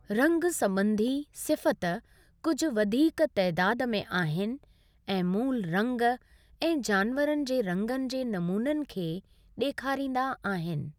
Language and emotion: Sindhi, neutral